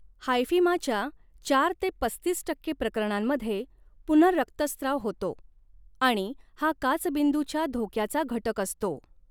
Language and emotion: Marathi, neutral